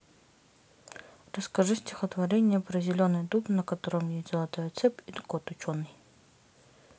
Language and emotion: Russian, neutral